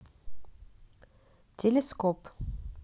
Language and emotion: Russian, neutral